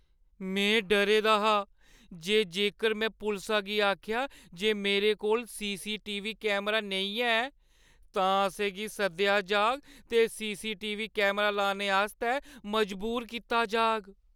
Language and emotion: Dogri, fearful